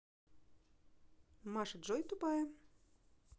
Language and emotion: Russian, neutral